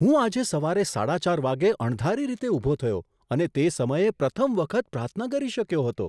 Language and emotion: Gujarati, surprised